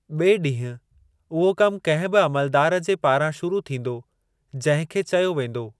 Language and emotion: Sindhi, neutral